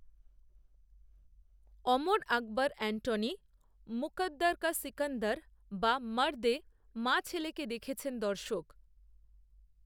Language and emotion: Bengali, neutral